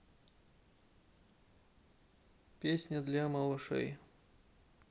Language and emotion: Russian, neutral